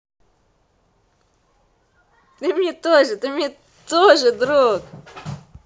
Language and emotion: Russian, positive